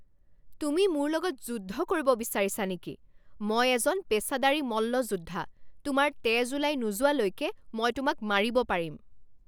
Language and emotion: Assamese, angry